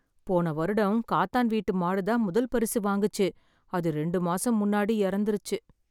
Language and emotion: Tamil, sad